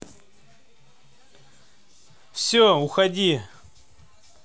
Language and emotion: Russian, angry